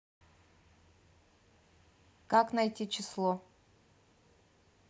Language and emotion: Russian, neutral